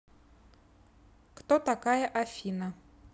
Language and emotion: Russian, neutral